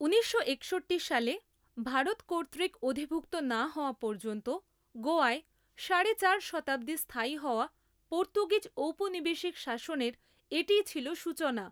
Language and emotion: Bengali, neutral